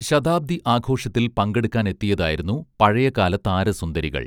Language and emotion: Malayalam, neutral